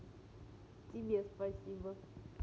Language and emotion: Russian, positive